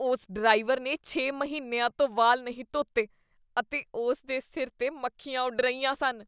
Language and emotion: Punjabi, disgusted